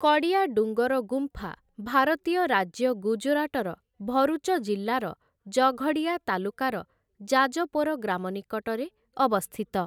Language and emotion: Odia, neutral